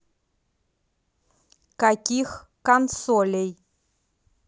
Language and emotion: Russian, neutral